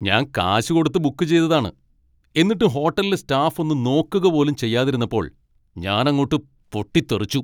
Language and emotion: Malayalam, angry